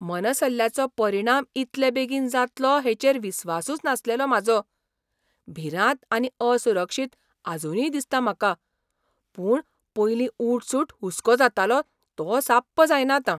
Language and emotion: Goan Konkani, surprised